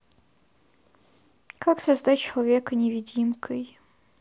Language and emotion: Russian, neutral